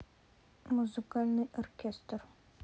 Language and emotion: Russian, neutral